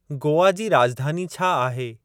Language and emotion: Sindhi, neutral